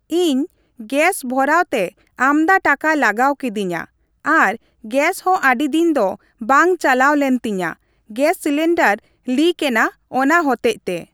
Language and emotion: Santali, neutral